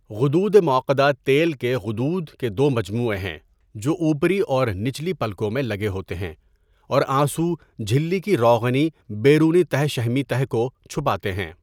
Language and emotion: Urdu, neutral